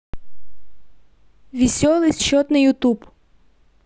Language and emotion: Russian, neutral